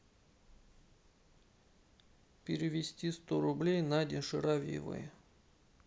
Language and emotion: Russian, sad